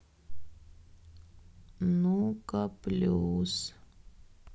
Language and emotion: Russian, sad